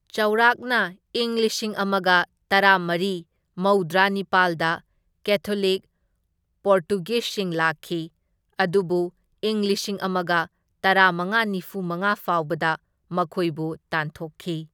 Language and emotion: Manipuri, neutral